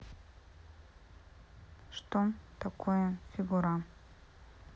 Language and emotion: Russian, neutral